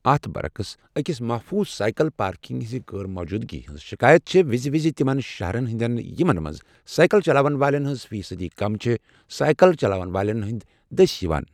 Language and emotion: Kashmiri, neutral